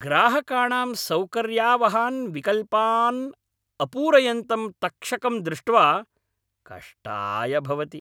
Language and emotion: Sanskrit, angry